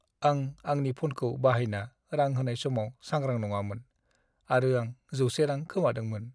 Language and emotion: Bodo, sad